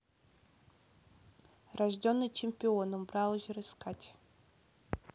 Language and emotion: Russian, neutral